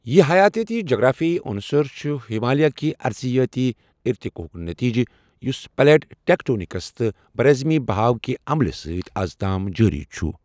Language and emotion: Kashmiri, neutral